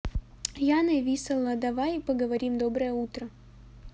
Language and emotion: Russian, neutral